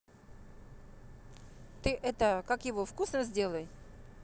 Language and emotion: Russian, neutral